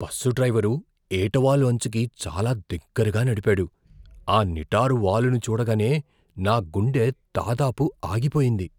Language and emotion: Telugu, fearful